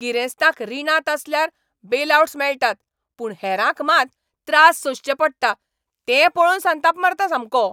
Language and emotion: Goan Konkani, angry